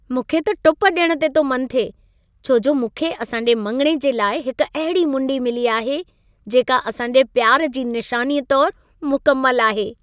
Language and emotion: Sindhi, happy